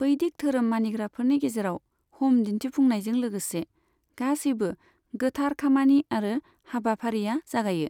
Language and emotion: Bodo, neutral